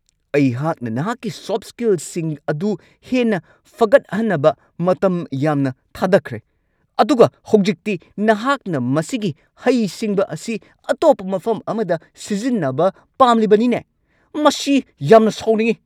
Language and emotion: Manipuri, angry